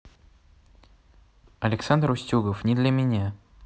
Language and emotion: Russian, neutral